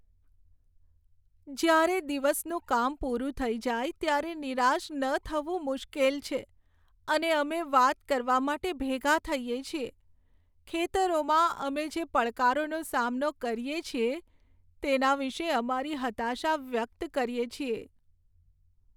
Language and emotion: Gujarati, sad